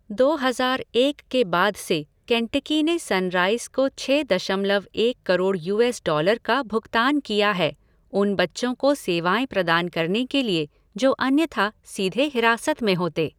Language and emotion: Hindi, neutral